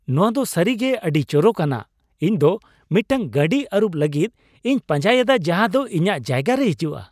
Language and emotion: Santali, happy